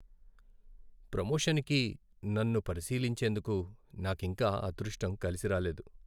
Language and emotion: Telugu, sad